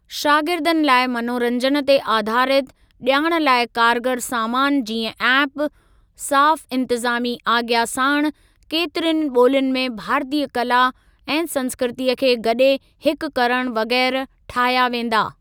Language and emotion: Sindhi, neutral